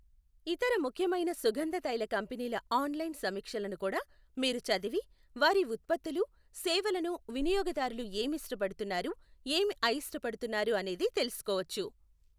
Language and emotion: Telugu, neutral